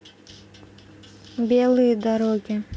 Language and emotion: Russian, neutral